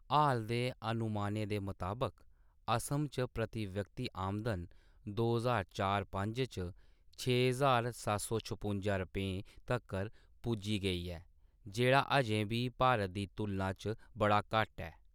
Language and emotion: Dogri, neutral